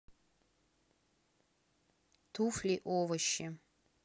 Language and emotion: Russian, neutral